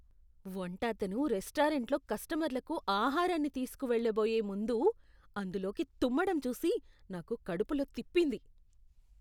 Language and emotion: Telugu, disgusted